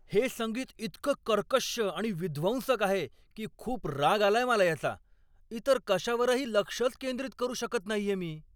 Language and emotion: Marathi, angry